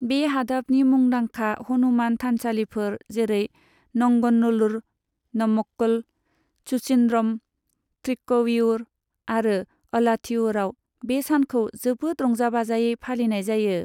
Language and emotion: Bodo, neutral